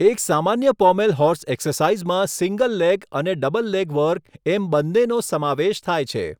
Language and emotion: Gujarati, neutral